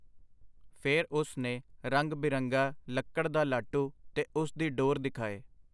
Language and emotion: Punjabi, neutral